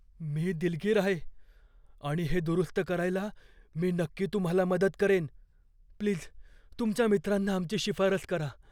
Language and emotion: Marathi, fearful